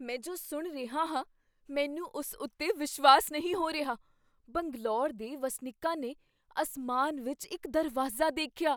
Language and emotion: Punjabi, surprised